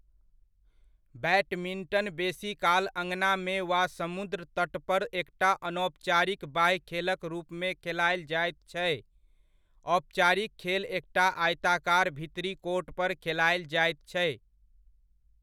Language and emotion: Maithili, neutral